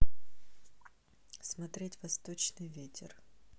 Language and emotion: Russian, neutral